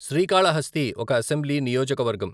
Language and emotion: Telugu, neutral